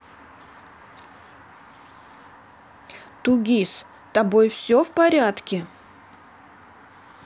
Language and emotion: Russian, neutral